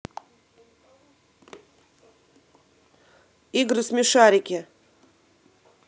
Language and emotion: Russian, positive